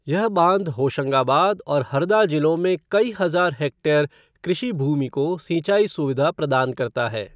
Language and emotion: Hindi, neutral